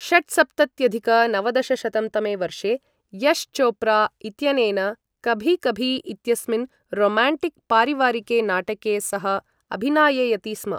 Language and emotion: Sanskrit, neutral